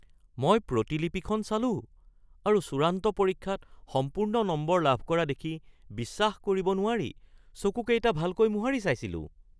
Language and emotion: Assamese, surprised